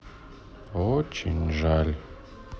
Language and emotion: Russian, sad